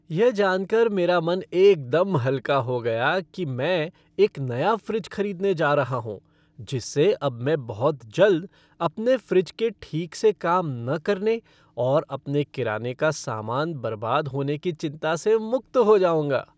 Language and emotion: Hindi, happy